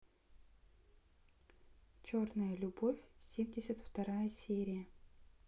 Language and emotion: Russian, neutral